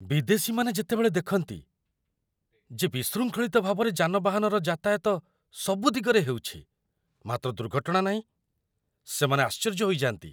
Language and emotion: Odia, surprised